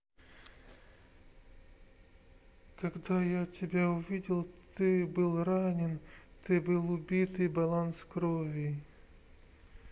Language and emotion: Russian, sad